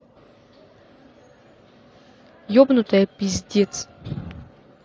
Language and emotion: Russian, angry